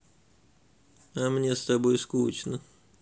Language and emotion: Russian, sad